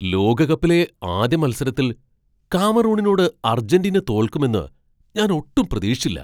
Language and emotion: Malayalam, surprised